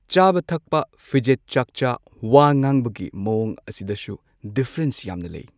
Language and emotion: Manipuri, neutral